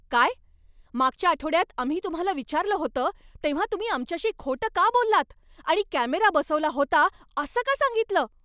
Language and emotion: Marathi, angry